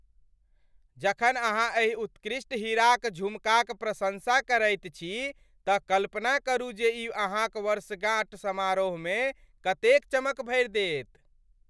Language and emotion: Maithili, happy